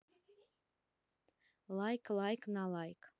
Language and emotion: Russian, neutral